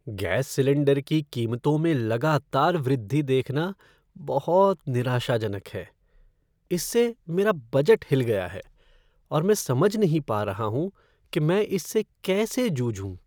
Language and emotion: Hindi, sad